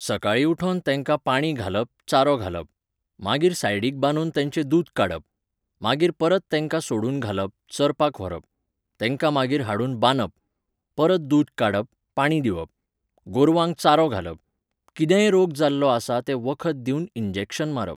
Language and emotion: Goan Konkani, neutral